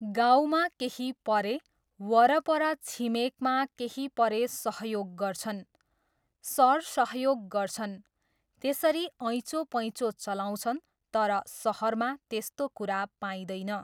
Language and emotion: Nepali, neutral